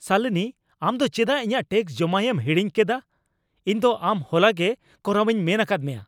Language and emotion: Santali, angry